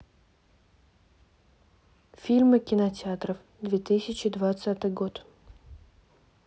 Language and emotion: Russian, neutral